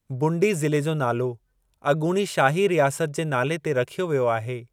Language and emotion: Sindhi, neutral